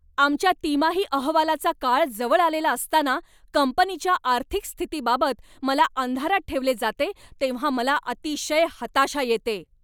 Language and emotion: Marathi, angry